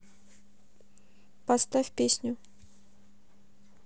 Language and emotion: Russian, neutral